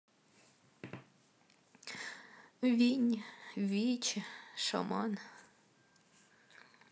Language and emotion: Russian, sad